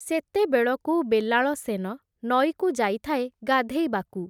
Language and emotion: Odia, neutral